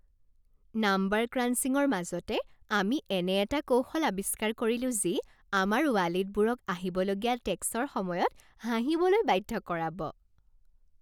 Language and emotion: Assamese, happy